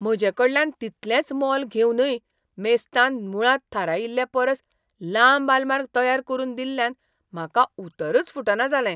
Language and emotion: Goan Konkani, surprised